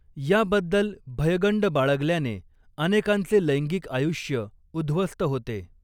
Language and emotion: Marathi, neutral